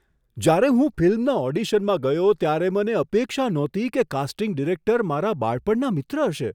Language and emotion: Gujarati, surprised